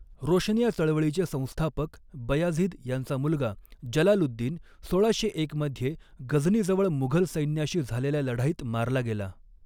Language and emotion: Marathi, neutral